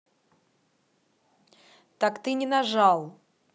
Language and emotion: Russian, angry